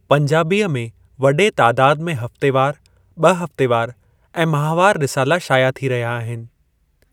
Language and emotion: Sindhi, neutral